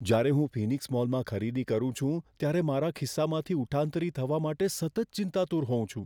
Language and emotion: Gujarati, fearful